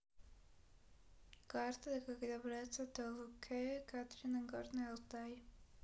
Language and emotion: Russian, neutral